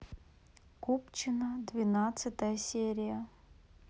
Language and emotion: Russian, neutral